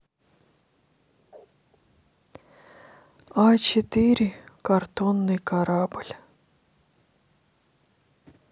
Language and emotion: Russian, sad